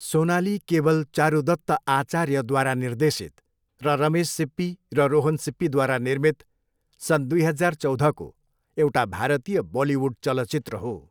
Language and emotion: Nepali, neutral